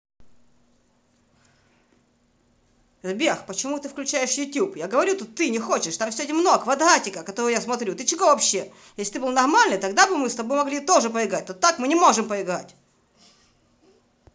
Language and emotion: Russian, angry